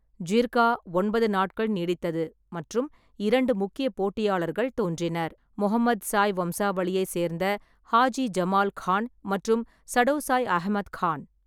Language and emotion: Tamil, neutral